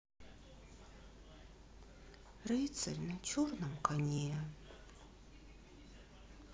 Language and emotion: Russian, sad